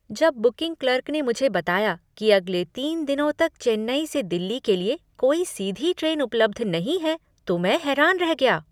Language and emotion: Hindi, surprised